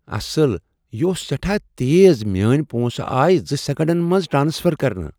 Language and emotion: Kashmiri, surprised